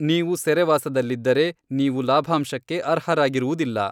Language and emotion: Kannada, neutral